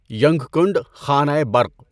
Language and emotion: Urdu, neutral